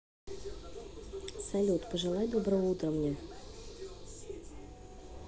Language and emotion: Russian, neutral